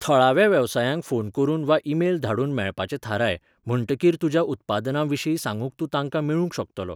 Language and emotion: Goan Konkani, neutral